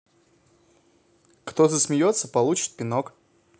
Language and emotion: Russian, positive